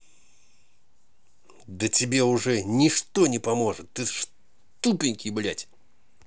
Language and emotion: Russian, angry